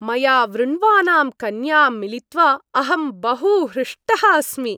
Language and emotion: Sanskrit, happy